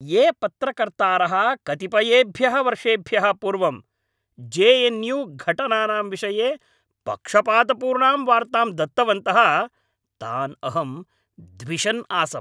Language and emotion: Sanskrit, angry